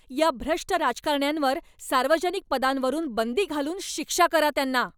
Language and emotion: Marathi, angry